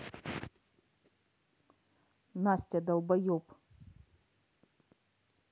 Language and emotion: Russian, angry